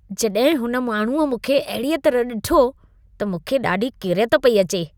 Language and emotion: Sindhi, disgusted